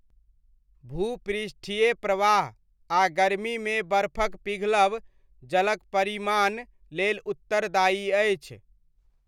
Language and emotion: Maithili, neutral